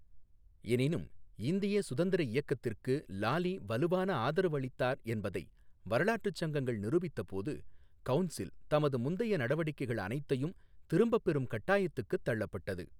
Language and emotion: Tamil, neutral